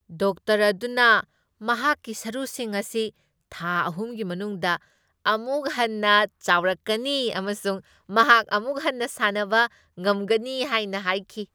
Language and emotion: Manipuri, happy